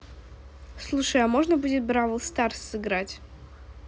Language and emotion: Russian, neutral